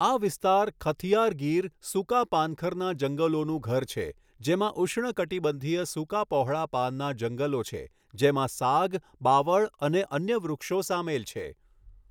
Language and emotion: Gujarati, neutral